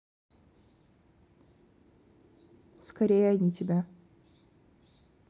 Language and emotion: Russian, neutral